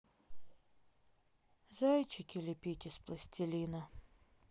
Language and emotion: Russian, sad